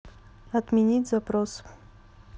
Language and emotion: Russian, neutral